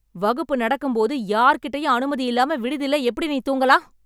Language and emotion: Tamil, angry